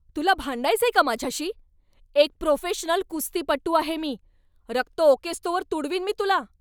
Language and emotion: Marathi, angry